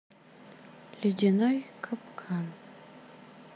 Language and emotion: Russian, sad